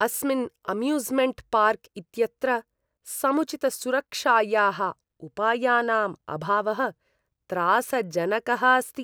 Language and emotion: Sanskrit, disgusted